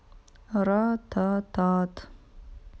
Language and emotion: Russian, neutral